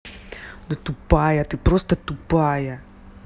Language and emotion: Russian, angry